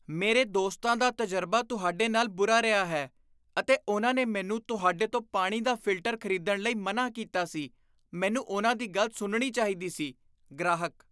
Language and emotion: Punjabi, disgusted